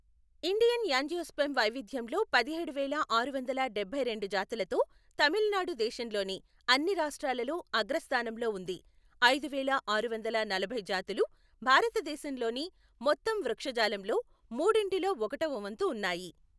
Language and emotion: Telugu, neutral